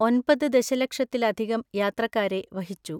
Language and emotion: Malayalam, neutral